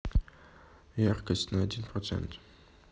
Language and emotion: Russian, neutral